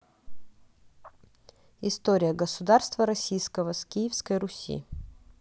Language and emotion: Russian, neutral